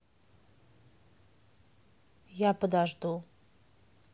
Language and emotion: Russian, neutral